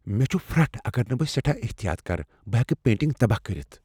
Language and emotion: Kashmiri, fearful